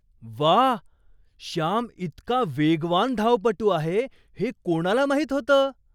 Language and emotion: Marathi, surprised